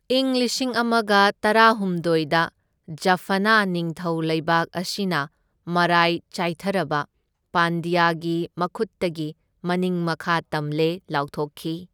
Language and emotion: Manipuri, neutral